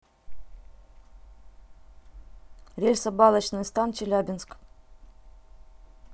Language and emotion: Russian, neutral